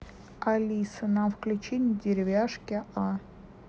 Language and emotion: Russian, neutral